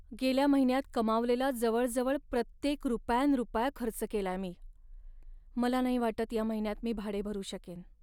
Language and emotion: Marathi, sad